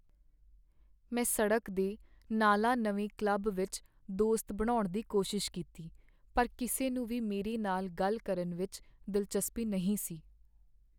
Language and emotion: Punjabi, sad